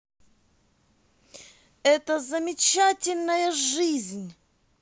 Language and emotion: Russian, positive